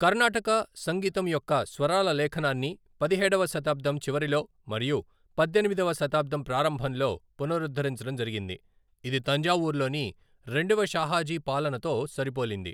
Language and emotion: Telugu, neutral